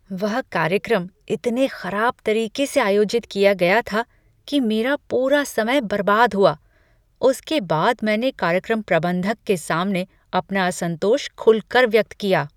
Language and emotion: Hindi, disgusted